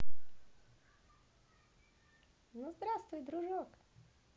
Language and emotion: Russian, positive